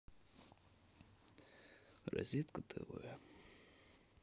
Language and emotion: Russian, sad